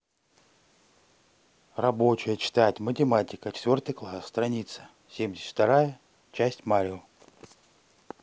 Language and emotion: Russian, neutral